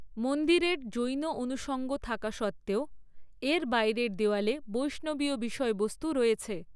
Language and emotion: Bengali, neutral